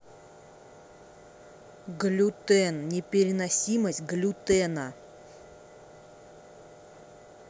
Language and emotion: Russian, angry